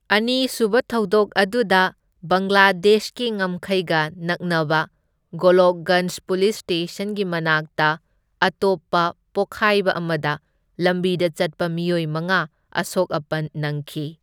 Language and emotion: Manipuri, neutral